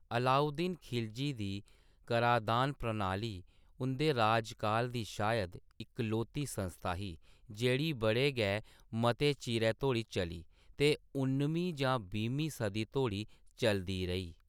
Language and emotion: Dogri, neutral